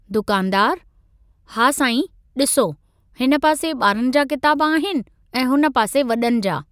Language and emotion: Sindhi, neutral